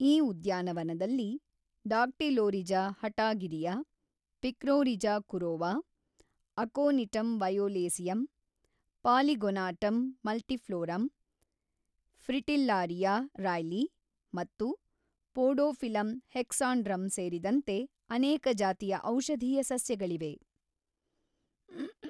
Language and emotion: Kannada, neutral